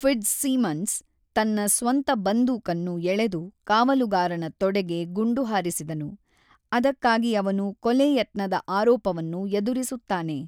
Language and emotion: Kannada, neutral